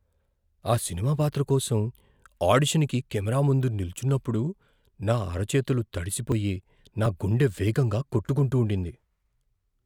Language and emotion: Telugu, fearful